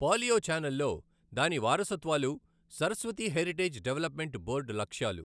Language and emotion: Telugu, neutral